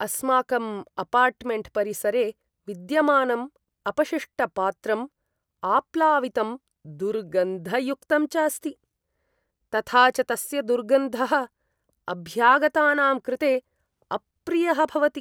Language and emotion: Sanskrit, disgusted